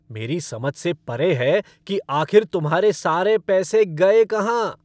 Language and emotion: Hindi, angry